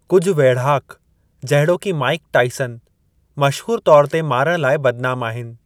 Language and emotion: Sindhi, neutral